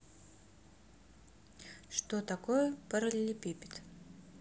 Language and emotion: Russian, neutral